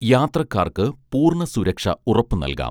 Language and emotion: Malayalam, neutral